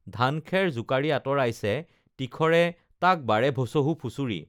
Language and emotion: Assamese, neutral